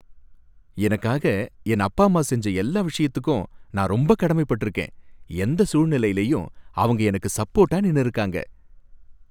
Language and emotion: Tamil, happy